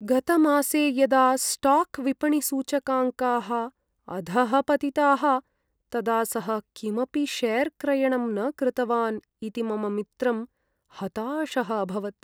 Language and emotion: Sanskrit, sad